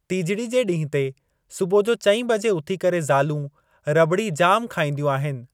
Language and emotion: Sindhi, neutral